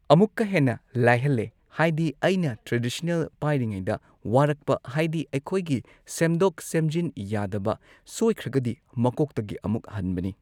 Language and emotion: Manipuri, neutral